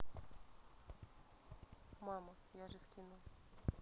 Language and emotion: Russian, neutral